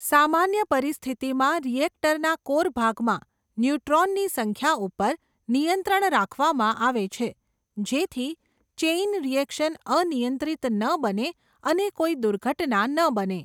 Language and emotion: Gujarati, neutral